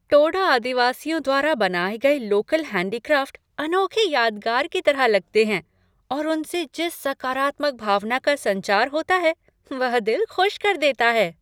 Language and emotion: Hindi, happy